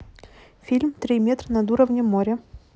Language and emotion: Russian, neutral